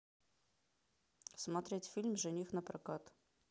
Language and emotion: Russian, neutral